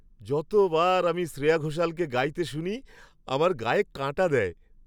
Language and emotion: Bengali, happy